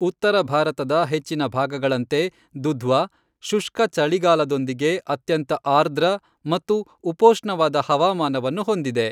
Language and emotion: Kannada, neutral